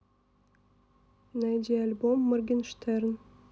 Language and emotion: Russian, neutral